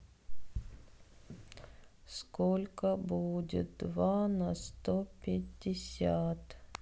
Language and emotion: Russian, sad